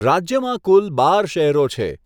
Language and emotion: Gujarati, neutral